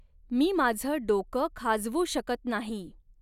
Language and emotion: Marathi, neutral